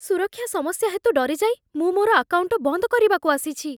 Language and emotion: Odia, fearful